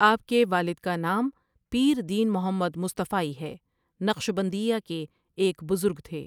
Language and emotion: Urdu, neutral